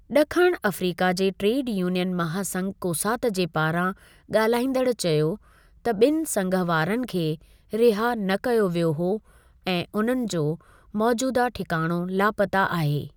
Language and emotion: Sindhi, neutral